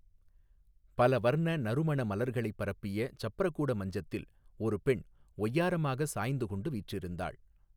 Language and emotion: Tamil, neutral